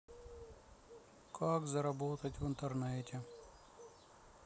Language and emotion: Russian, sad